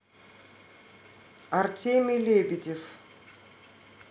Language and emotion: Russian, neutral